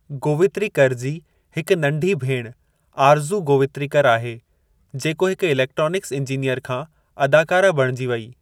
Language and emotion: Sindhi, neutral